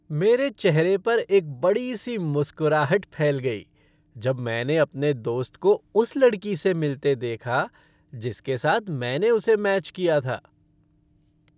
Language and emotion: Hindi, happy